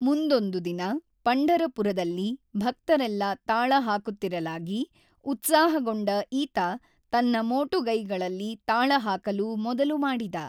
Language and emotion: Kannada, neutral